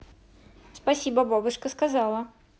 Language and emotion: Russian, positive